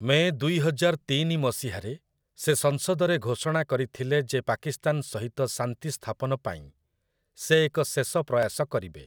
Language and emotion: Odia, neutral